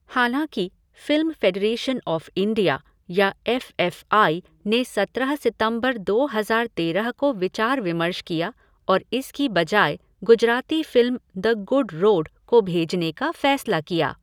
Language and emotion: Hindi, neutral